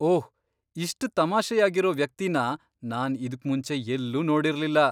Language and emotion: Kannada, surprised